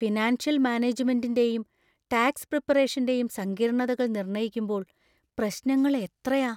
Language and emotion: Malayalam, fearful